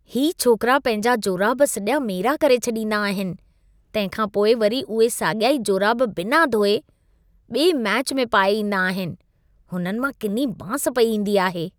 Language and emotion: Sindhi, disgusted